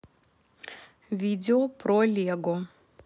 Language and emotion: Russian, neutral